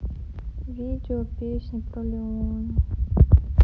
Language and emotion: Russian, sad